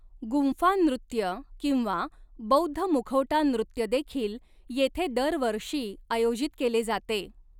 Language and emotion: Marathi, neutral